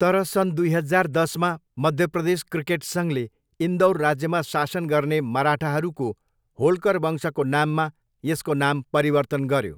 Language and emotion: Nepali, neutral